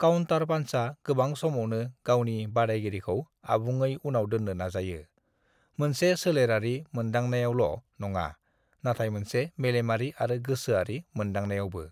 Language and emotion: Bodo, neutral